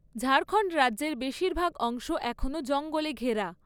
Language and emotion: Bengali, neutral